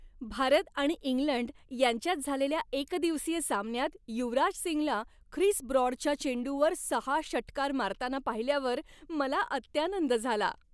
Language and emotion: Marathi, happy